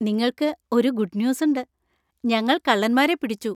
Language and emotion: Malayalam, happy